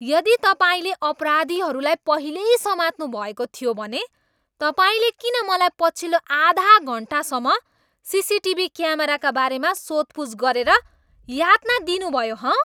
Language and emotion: Nepali, angry